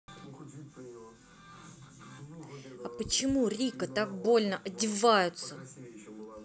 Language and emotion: Russian, angry